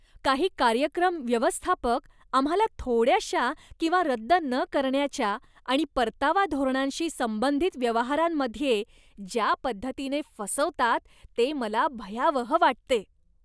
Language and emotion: Marathi, disgusted